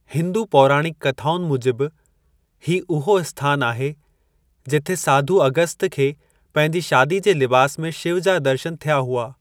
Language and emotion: Sindhi, neutral